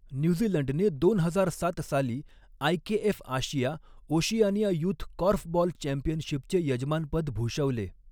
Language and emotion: Marathi, neutral